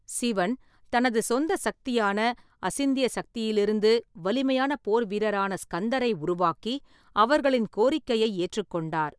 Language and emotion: Tamil, neutral